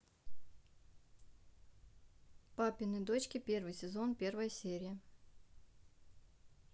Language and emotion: Russian, neutral